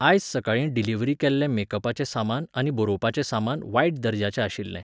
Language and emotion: Goan Konkani, neutral